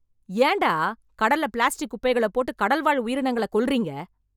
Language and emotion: Tamil, angry